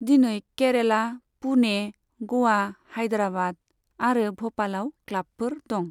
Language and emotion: Bodo, neutral